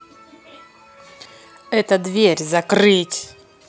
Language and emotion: Russian, angry